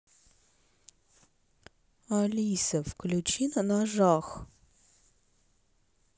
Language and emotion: Russian, sad